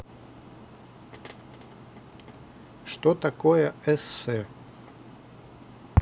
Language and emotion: Russian, neutral